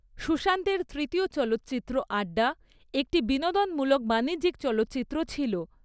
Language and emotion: Bengali, neutral